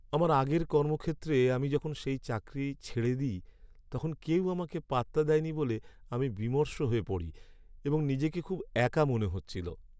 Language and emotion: Bengali, sad